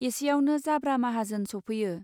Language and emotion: Bodo, neutral